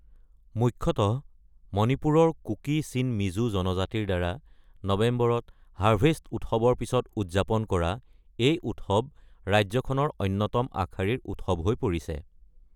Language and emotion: Assamese, neutral